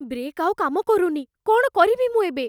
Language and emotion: Odia, fearful